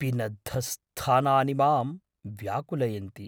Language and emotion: Sanskrit, fearful